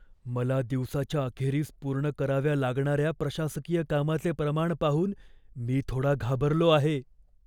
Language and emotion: Marathi, fearful